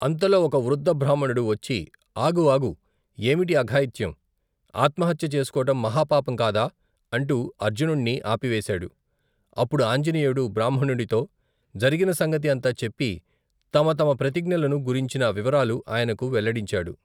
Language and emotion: Telugu, neutral